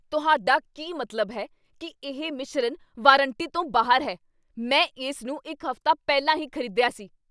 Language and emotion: Punjabi, angry